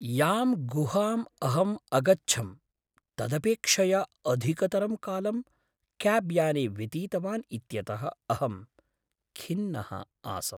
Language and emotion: Sanskrit, sad